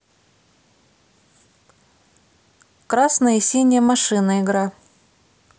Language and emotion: Russian, neutral